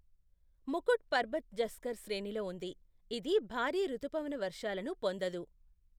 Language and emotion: Telugu, neutral